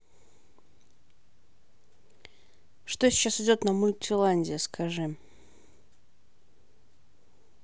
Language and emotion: Russian, neutral